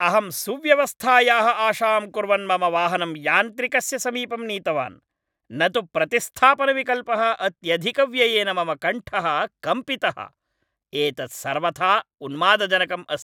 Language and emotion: Sanskrit, angry